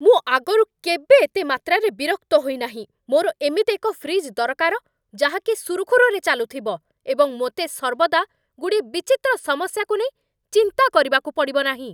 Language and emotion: Odia, angry